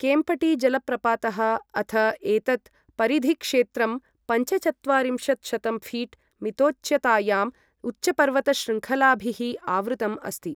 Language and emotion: Sanskrit, neutral